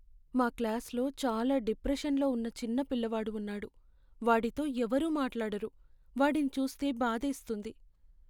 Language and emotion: Telugu, sad